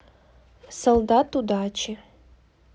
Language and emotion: Russian, neutral